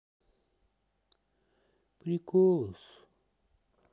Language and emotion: Russian, sad